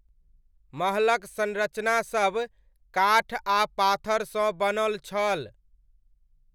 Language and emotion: Maithili, neutral